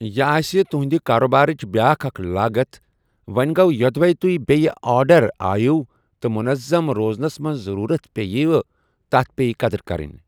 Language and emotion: Kashmiri, neutral